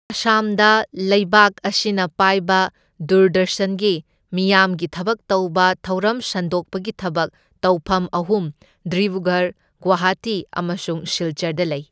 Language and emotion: Manipuri, neutral